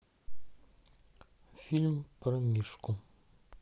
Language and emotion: Russian, neutral